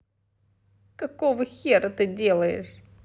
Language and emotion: Russian, angry